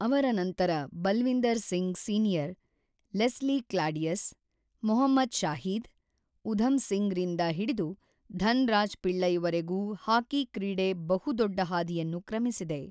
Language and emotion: Kannada, neutral